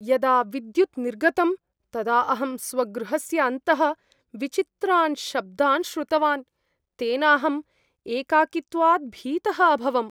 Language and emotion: Sanskrit, fearful